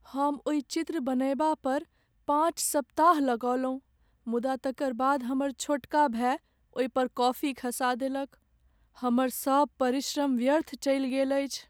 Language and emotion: Maithili, sad